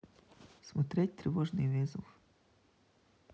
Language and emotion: Russian, neutral